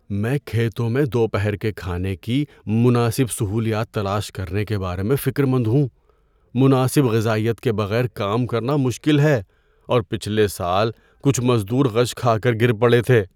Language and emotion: Urdu, fearful